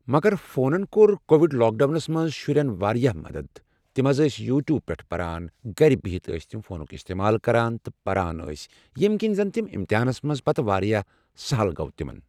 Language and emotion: Kashmiri, neutral